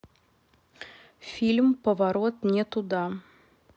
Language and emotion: Russian, neutral